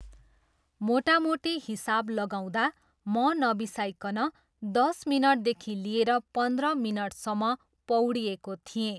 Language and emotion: Nepali, neutral